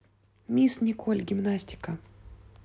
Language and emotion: Russian, neutral